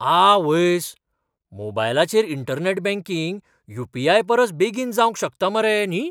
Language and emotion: Goan Konkani, surprised